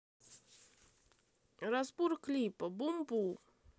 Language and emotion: Russian, neutral